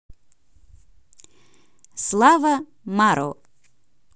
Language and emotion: Russian, positive